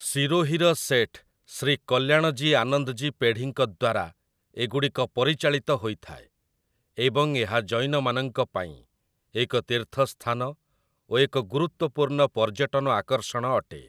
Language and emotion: Odia, neutral